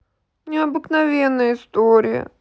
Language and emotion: Russian, sad